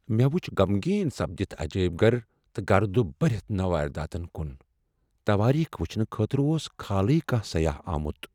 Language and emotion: Kashmiri, sad